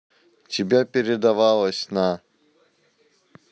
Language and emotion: Russian, neutral